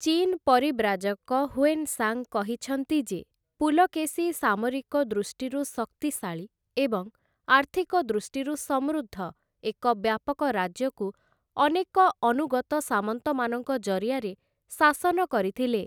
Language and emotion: Odia, neutral